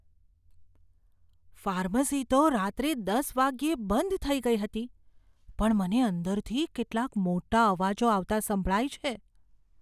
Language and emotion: Gujarati, fearful